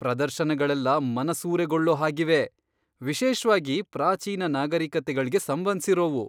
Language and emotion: Kannada, surprised